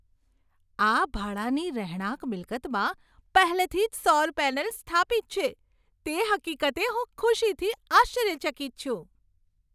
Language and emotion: Gujarati, surprised